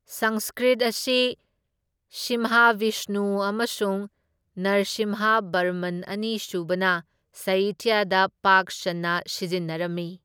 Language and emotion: Manipuri, neutral